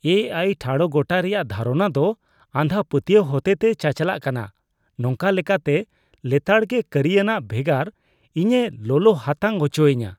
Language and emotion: Santali, disgusted